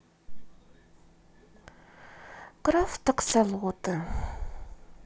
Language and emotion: Russian, sad